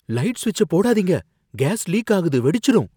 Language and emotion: Tamil, fearful